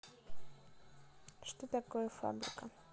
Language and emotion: Russian, neutral